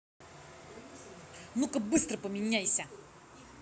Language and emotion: Russian, angry